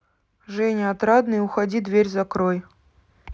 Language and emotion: Russian, neutral